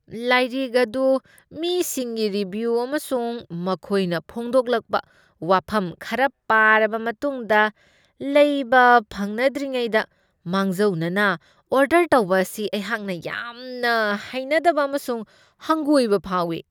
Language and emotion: Manipuri, disgusted